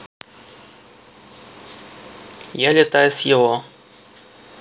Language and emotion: Russian, neutral